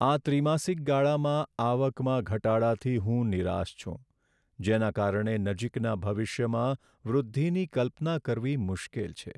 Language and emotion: Gujarati, sad